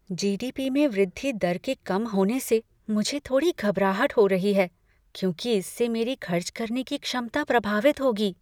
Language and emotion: Hindi, fearful